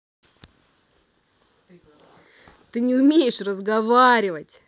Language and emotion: Russian, angry